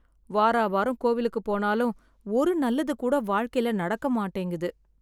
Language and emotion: Tamil, sad